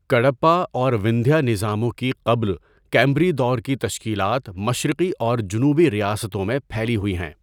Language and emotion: Urdu, neutral